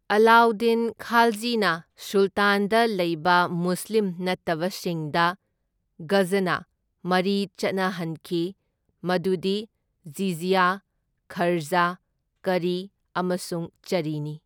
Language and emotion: Manipuri, neutral